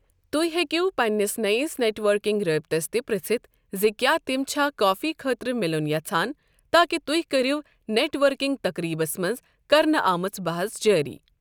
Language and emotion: Kashmiri, neutral